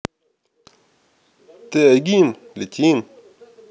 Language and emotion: Russian, neutral